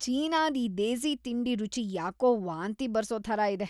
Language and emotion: Kannada, disgusted